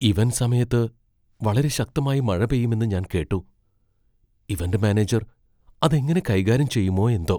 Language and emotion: Malayalam, fearful